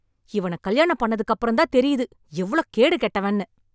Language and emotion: Tamil, angry